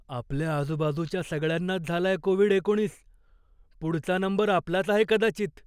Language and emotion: Marathi, fearful